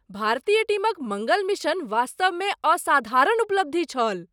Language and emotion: Maithili, surprised